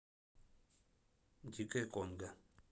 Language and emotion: Russian, neutral